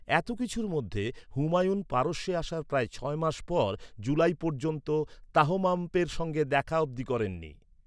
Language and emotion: Bengali, neutral